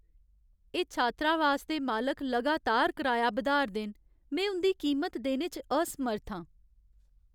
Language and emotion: Dogri, sad